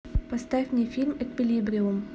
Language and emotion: Russian, neutral